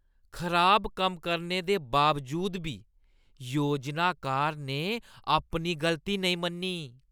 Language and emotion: Dogri, disgusted